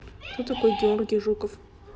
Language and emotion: Russian, neutral